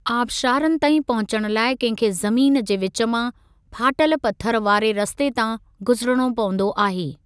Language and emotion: Sindhi, neutral